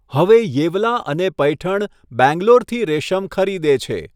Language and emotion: Gujarati, neutral